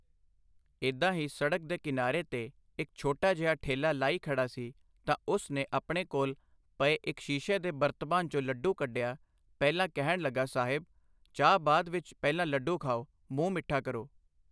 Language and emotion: Punjabi, neutral